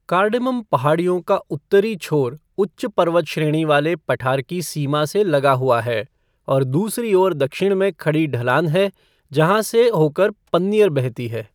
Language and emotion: Hindi, neutral